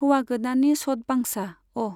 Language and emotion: Bodo, neutral